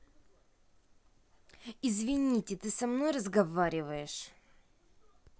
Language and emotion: Russian, angry